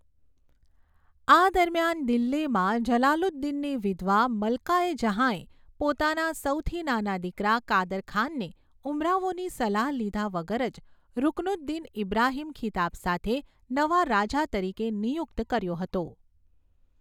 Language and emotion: Gujarati, neutral